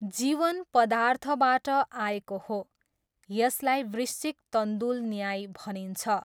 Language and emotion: Nepali, neutral